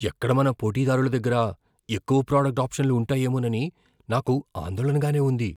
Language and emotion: Telugu, fearful